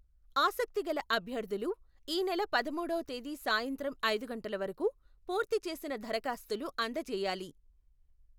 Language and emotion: Telugu, neutral